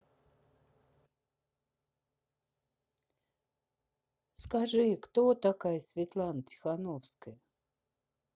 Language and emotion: Russian, neutral